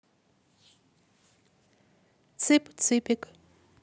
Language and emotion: Russian, neutral